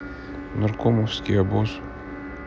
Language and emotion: Russian, neutral